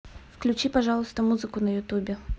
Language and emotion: Russian, neutral